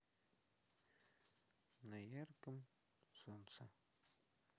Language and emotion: Russian, neutral